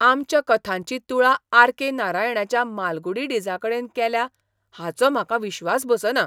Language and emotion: Goan Konkani, surprised